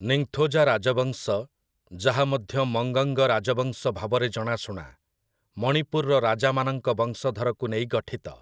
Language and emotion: Odia, neutral